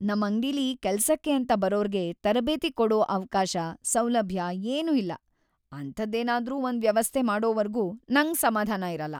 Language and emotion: Kannada, sad